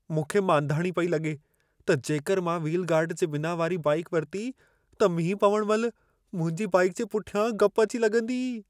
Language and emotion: Sindhi, fearful